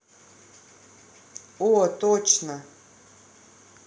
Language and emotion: Russian, positive